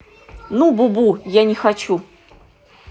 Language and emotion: Russian, angry